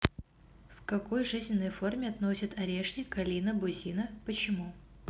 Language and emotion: Russian, neutral